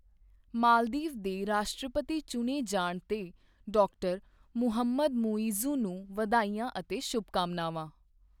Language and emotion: Punjabi, neutral